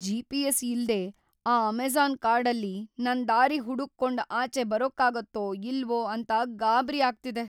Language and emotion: Kannada, fearful